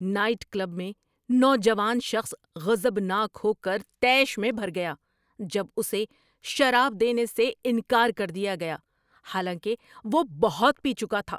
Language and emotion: Urdu, angry